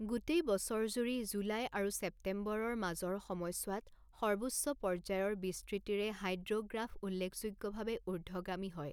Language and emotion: Assamese, neutral